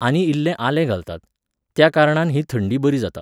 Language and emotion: Goan Konkani, neutral